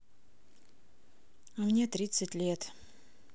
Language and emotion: Russian, sad